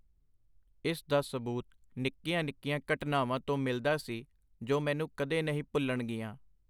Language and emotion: Punjabi, neutral